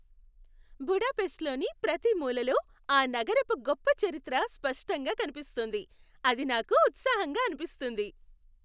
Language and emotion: Telugu, happy